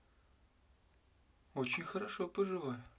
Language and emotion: Russian, neutral